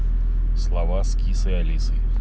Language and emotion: Russian, neutral